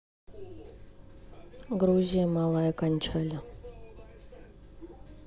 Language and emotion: Russian, neutral